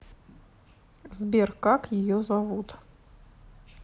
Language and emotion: Russian, neutral